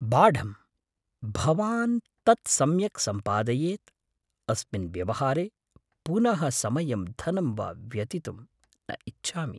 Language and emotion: Sanskrit, fearful